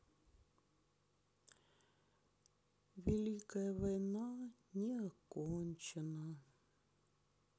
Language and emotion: Russian, sad